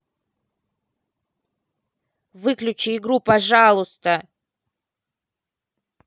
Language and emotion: Russian, angry